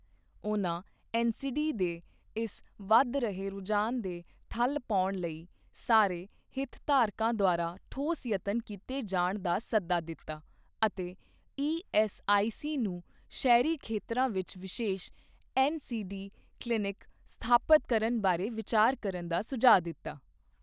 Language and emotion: Punjabi, neutral